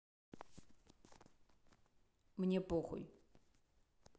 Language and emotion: Russian, neutral